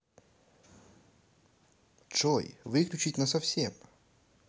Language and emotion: Russian, neutral